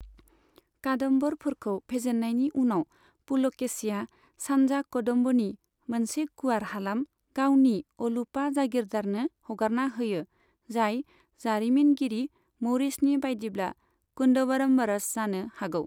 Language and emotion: Bodo, neutral